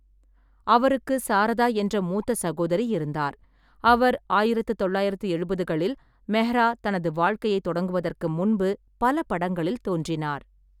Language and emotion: Tamil, neutral